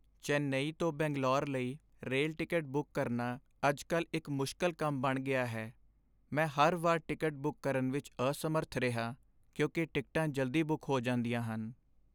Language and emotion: Punjabi, sad